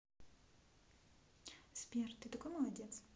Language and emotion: Russian, neutral